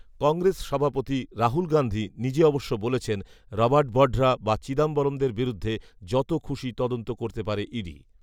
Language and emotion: Bengali, neutral